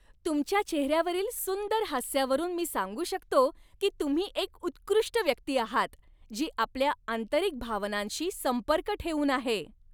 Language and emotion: Marathi, happy